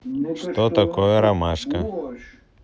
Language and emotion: Russian, neutral